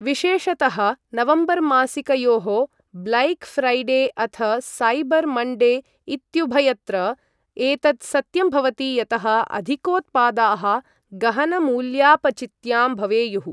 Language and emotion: Sanskrit, neutral